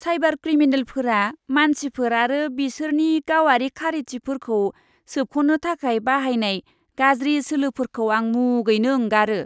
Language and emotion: Bodo, disgusted